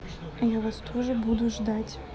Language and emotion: Russian, neutral